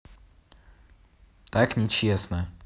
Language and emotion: Russian, neutral